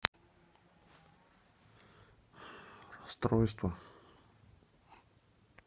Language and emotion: Russian, sad